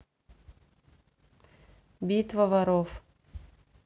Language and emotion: Russian, neutral